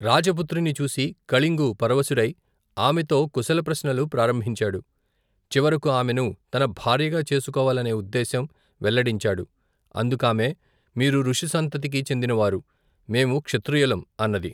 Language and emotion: Telugu, neutral